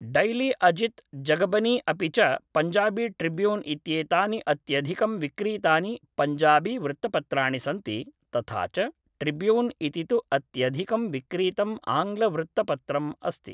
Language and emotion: Sanskrit, neutral